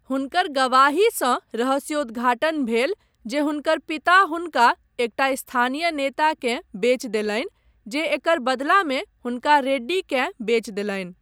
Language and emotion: Maithili, neutral